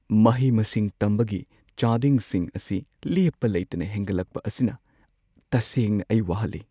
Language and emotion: Manipuri, sad